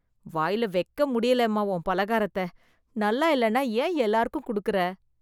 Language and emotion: Tamil, disgusted